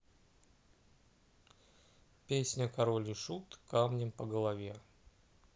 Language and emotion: Russian, neutral